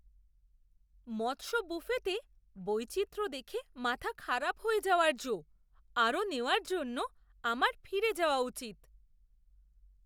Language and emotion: Bengali, surprised